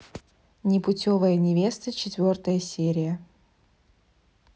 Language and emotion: Russian, neutral